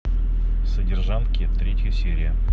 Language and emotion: Russian, neutral